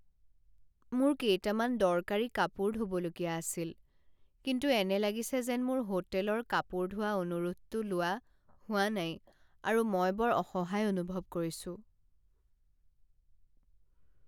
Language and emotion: Assamese, sad